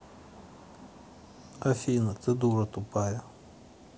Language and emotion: Russian, neutral